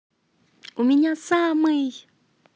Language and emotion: Russian, positive